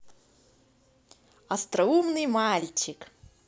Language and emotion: Russian, positive